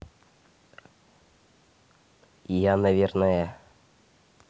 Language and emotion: Russian, neutral